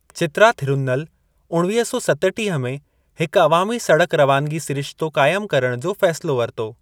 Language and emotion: Sindhi, neutral